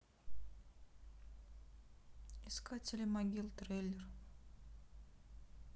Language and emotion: Russian, sad